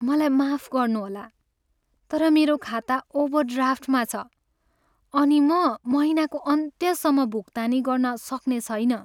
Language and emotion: Nepali, sad